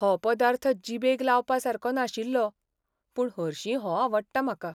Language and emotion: Goan Konkani, sad